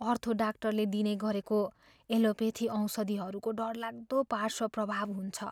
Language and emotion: Nepali, fearful